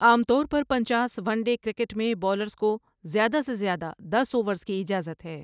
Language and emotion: Urdu, neutral